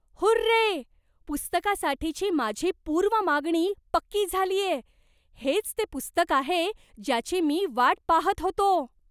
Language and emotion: Marathi, surprised